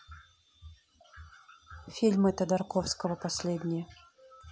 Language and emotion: Russian, neutral